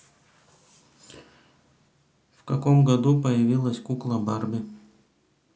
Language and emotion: Russian, neutral